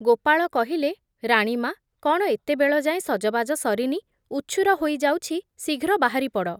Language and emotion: Odia, neutral